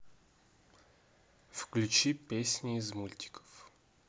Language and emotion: Russian, neutral